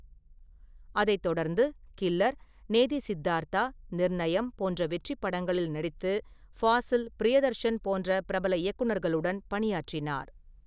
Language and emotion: Tamil, neutral